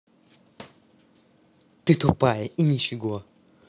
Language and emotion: Russian, angry